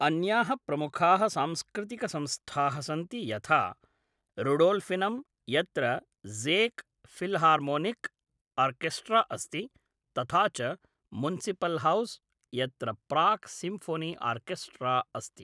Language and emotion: Sanskrit, neutral